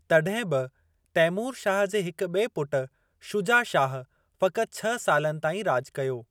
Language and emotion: Sindhi, neutral